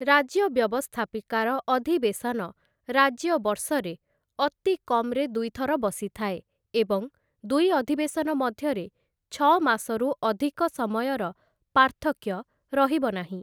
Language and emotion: Odia, neutral